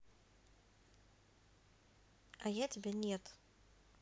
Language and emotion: Russian, neutral